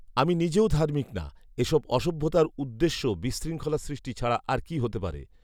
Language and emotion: Bengali, neutral